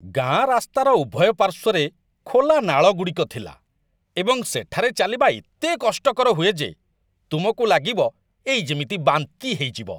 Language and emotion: Odia, disgusted